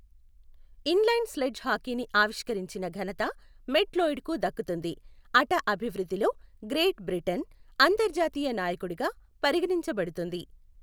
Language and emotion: Telugu, neutral